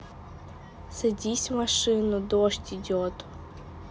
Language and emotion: Russian, neutral